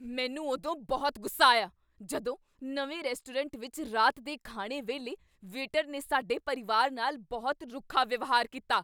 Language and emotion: Punjabi, angry